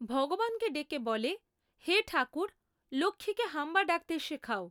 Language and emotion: Bengali, neutral